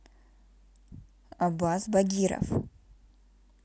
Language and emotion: Russian, neutral